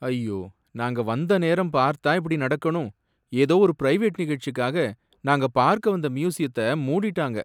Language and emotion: Tamil, sad